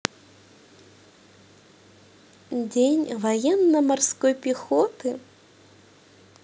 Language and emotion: Russian, positive